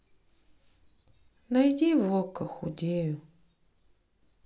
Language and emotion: Russian, sad